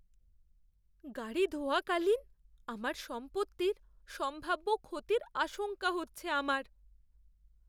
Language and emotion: Bengali, fearful